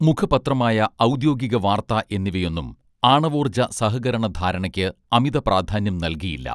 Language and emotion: Malayalam, neutral